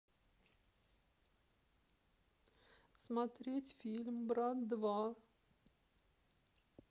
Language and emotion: Russian, sad